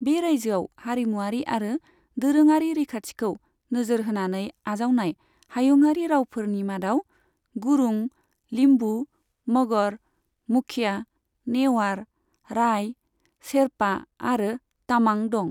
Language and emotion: Bodo, neutral